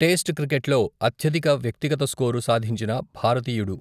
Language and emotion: Telugu, neutral